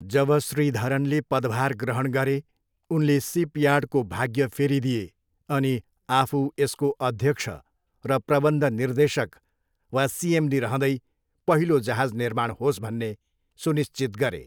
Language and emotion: Nepali, neutral